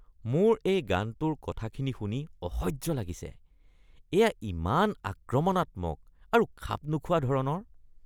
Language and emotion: Assamese, disgusted